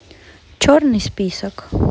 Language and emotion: Russian, neutral